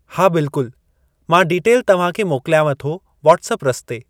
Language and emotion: Sindhi, neutral